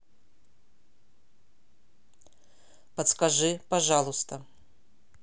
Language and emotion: Russian, neutral